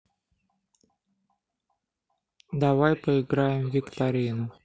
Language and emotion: Russian, neutral